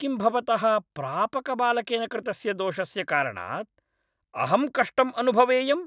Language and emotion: Sanskrit, angry